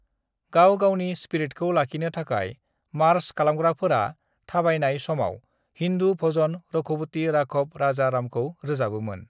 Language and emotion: Bodo, neutral